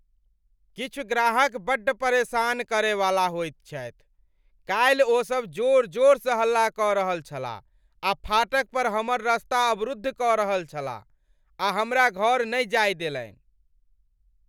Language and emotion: Maithili, angry